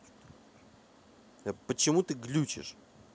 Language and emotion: Russian, angry